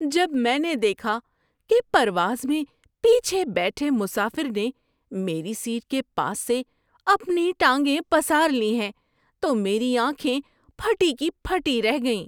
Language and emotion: Urdu, surprised